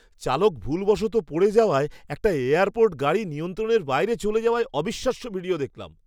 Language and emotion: Bengali, surprised